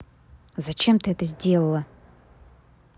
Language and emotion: Russian, angry